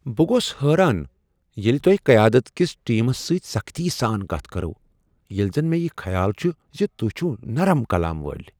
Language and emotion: Kashmiri, surprised